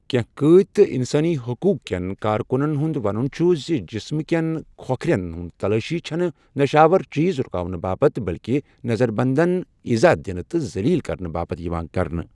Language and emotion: Kashmiri, neutral